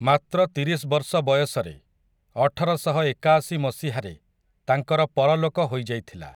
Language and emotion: Odia, neutral